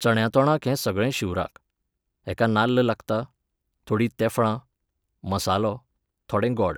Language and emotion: Goan Konkani, neutral